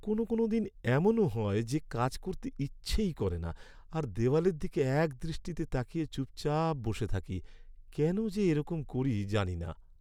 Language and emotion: Bengali, sad